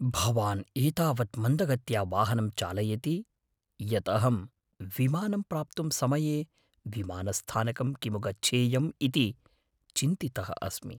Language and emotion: Sanskrit, fearful